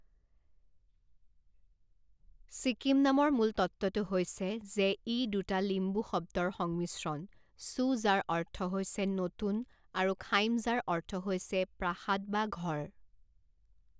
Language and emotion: Assamese, neutral